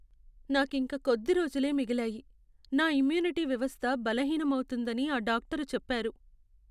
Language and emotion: Telugu, sad